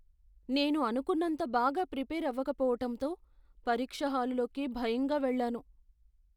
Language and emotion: Telugu, fearful